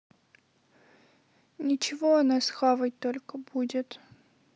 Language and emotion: Russian, sad